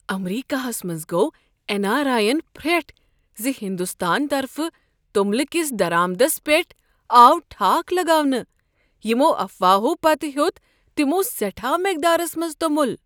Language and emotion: Kashmiri, surprised